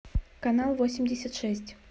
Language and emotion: Russian, neutral